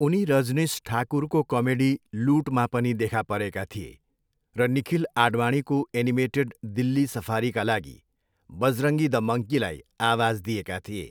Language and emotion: Nepali, neutral